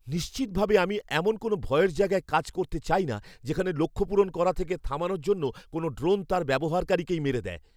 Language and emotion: Bengali, fearful